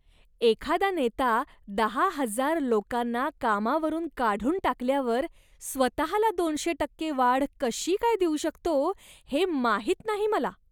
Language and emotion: Marathi, disgusted